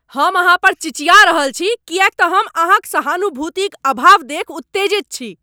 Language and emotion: Maithili, angry